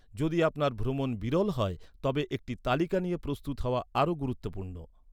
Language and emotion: Bengali, neutral